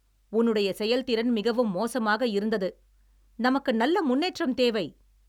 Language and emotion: Tamil, angry